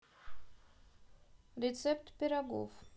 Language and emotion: Russian, neutral